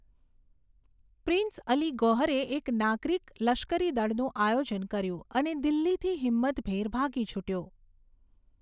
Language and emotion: Gujarati, neutral